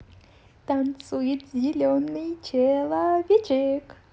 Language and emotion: Russian, positive